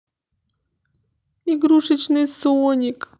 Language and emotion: Russian, sad